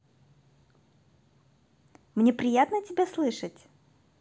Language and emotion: Russian, positive